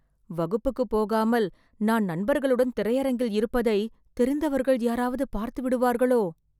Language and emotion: Tamil, fearful